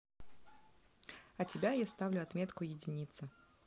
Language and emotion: Russian, neutral